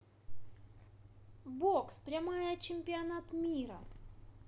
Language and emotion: Russian, positive